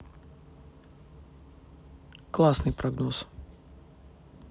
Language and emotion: Russian, neutral